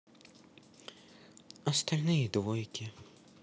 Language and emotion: Russian, sad